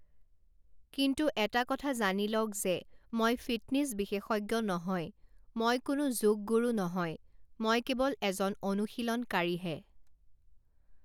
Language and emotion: Assamese, neutral